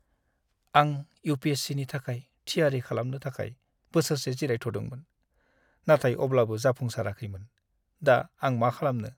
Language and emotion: Bodo, sad